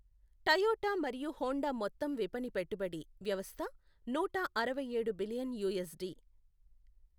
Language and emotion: Telugu, neutral